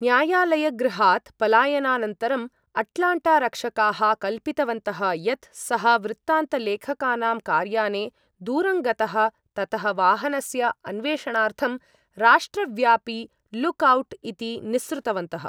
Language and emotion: Sanskrit, neutral